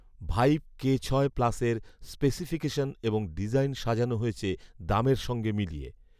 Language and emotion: Bengali, neutral